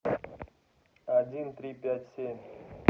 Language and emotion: Russian, neutral